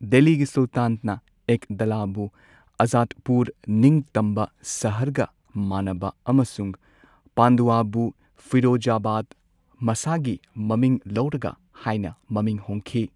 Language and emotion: Manipuri, neutral